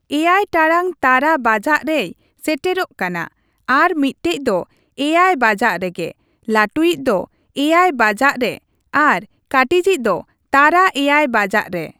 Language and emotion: Santali, neutral